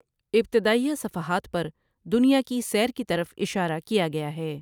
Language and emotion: Urdu, neutral